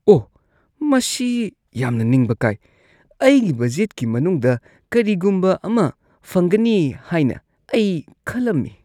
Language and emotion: Manipuri, disgusted